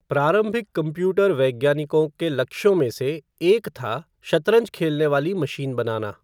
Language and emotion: Hindi, neutral